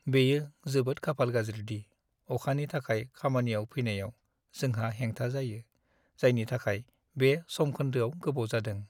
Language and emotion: Bodo, sad